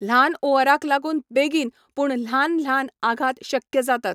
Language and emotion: Goan Konkani, neutral